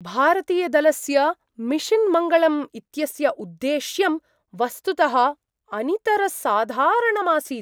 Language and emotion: Sanskrit, surprised